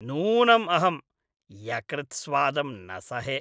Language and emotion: Sanskrit, disgusted